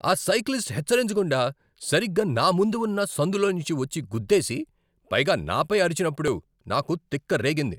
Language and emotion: Telugu, angry